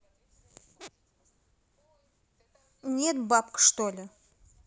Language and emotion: Russian, angry